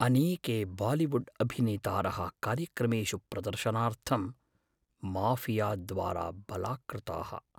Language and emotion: Sanskrit, fearful